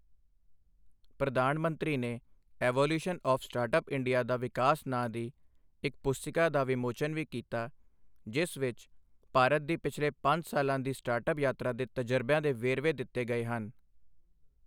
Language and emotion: Punjabi, neutral